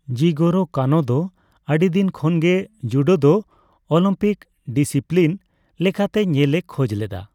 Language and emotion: Santali, neutral